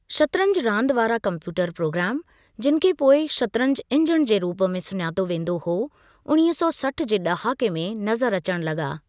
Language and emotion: Sindhi, neutral